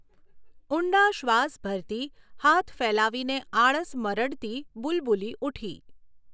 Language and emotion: Gujarati, neutral